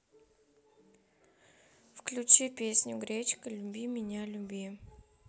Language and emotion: Russian, neutral